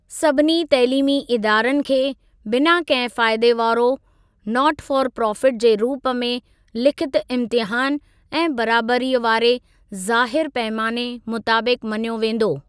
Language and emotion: Sindhi, neutral